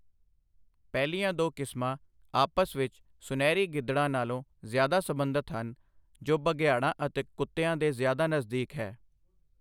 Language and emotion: Punjabi, neutral